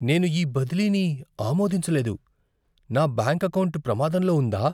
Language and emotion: Telugu, fearful